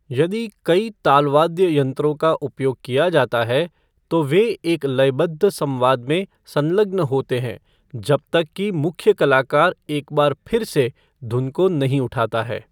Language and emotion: Hindi, neutral